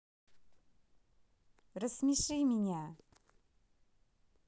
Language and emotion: Russian, neutral